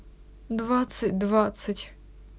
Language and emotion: Russian, sad